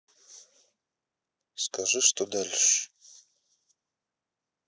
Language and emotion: Russian, neutral